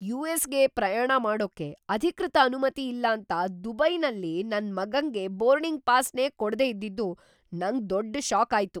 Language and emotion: Kannada, surprised